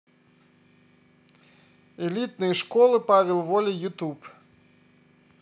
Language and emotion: Russian, neutral